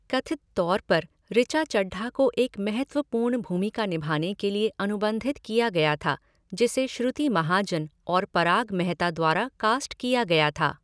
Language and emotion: Hindi, neutral